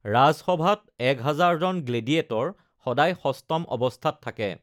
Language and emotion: Assamese, neutral